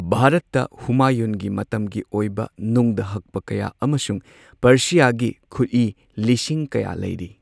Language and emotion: Manipuri, neutral